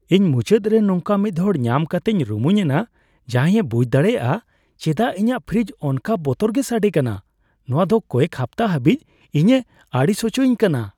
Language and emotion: Santali, happy